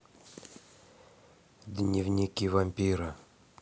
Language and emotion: Russian, neutral